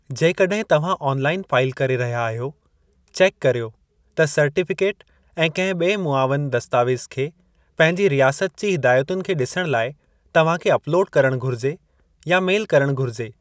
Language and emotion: Sindhi, neutral